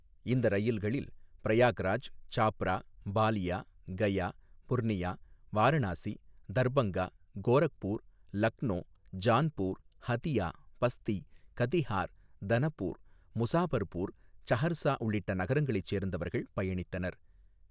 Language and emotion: Tamil, neutral